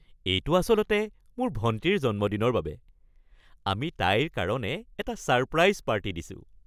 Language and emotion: Assamese, happy